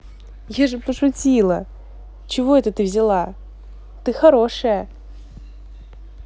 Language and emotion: Russian, positive